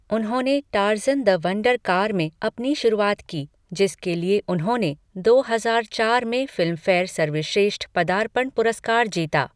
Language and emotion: Hindi, neutral